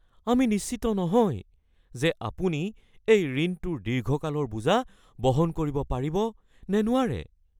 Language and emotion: Assamese, fearful